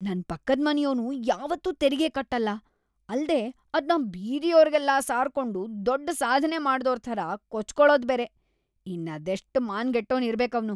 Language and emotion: Kannada, disgusted